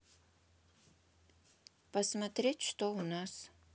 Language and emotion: Russian, neutral